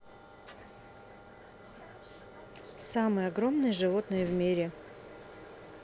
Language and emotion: Russian, neutral